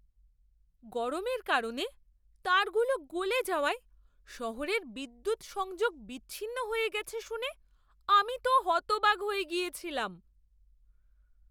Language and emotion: Bengali, surprised